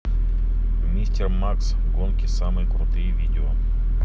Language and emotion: Russian, neutral